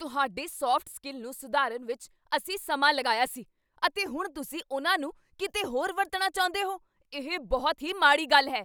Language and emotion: Punjabi, angry